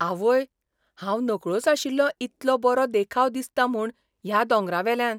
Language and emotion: Goan Konkani, surprised